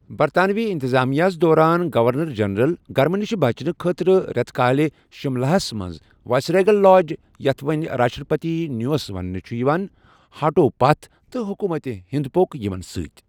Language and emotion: Kashmiri, neutral